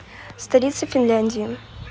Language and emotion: Russian, neutral